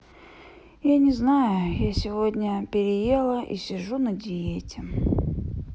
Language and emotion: Russian, sad